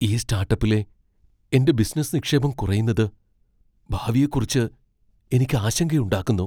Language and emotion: Malayalam, fearful